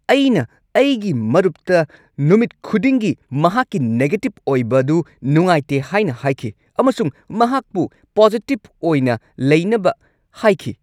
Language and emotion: Manipuri, angry